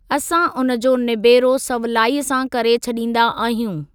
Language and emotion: Sindhi, neutral